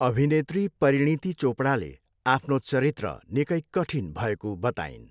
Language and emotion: Nepali, neutral